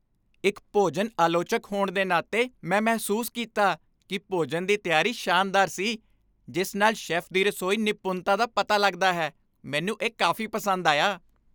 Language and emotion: Punjabi, happy